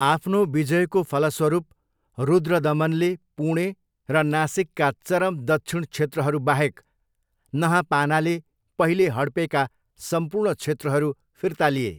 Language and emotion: Nepali, neutral